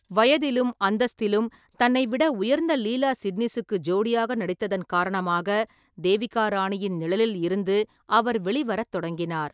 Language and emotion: Tamil, neutral